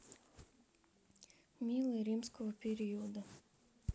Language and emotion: Russian, sad